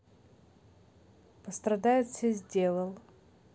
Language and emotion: Russian, neutral